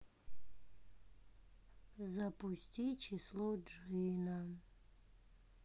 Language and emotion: Russian, sad